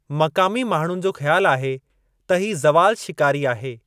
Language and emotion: Sindhi, neutral